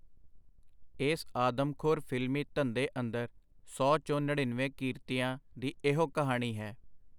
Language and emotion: Punjabi, neutral